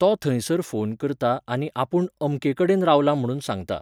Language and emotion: Goan Konkani, neutral